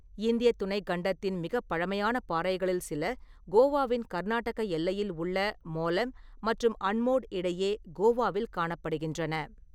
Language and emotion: Tamil, neutral